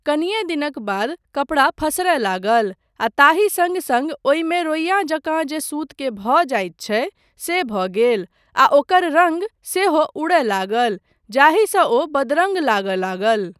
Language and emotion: Maithili, neutral